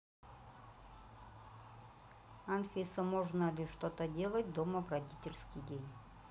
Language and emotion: Russian, neutral